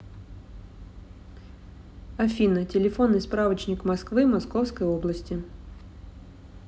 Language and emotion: Russian, neutral